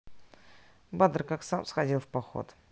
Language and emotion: Russian, neutral